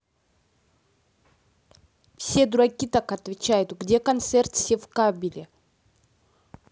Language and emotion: Russian, neutral